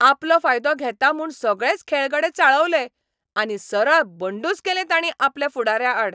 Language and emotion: Goan Konkani, angry